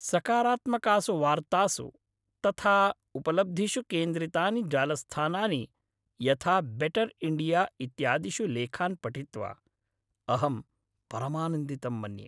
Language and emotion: Sanskrit, happy